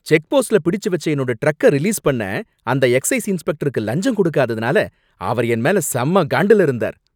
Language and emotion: Tamil, angry